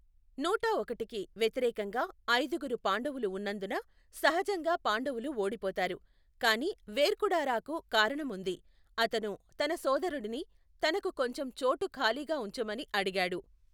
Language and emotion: Telugu, neutral